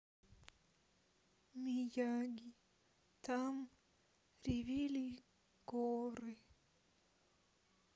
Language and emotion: Russian, sad